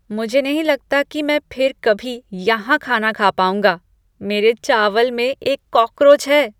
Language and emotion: Hindi, disgusted